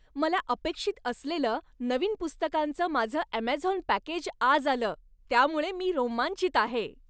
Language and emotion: Marathi, happy